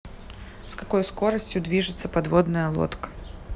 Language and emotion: Russian, neutral